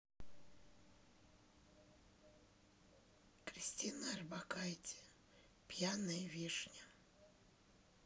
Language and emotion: Russian, neutral